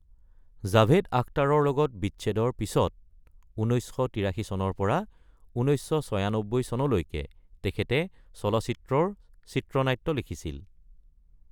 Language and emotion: Assamese, neutral